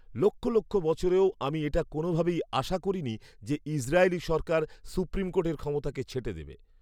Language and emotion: Bengali, surprised